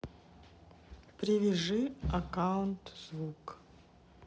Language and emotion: Russian, neutral